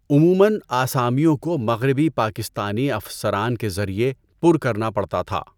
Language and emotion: Urdu, neutral